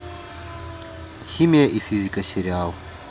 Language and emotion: Russian, neutral